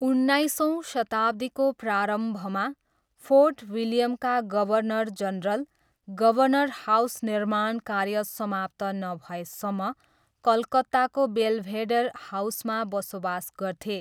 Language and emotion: Nepali, neutral